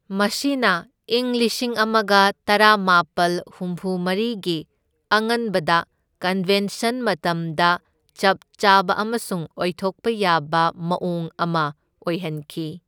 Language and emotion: Manipuri, neutral